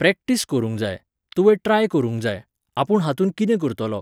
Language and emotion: Goan Konkani, neutral